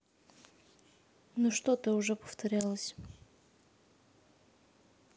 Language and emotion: Russian, neutral